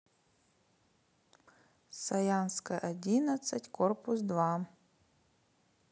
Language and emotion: Russian, neutral